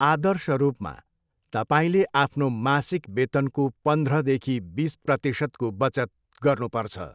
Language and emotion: Nepali, neutral